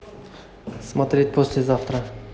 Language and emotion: Russian, neutral